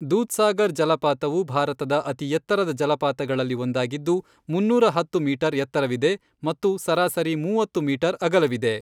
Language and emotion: Kannada, neutral